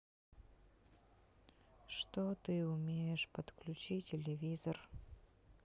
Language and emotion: Russian, sad